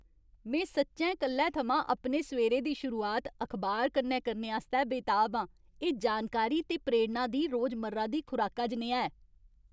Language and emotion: Dogri, happy